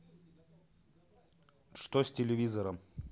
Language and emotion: Russian, neutral